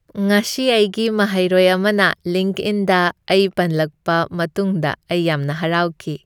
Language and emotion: Manipuri, happy